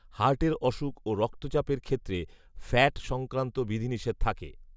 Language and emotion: Bengali, neutral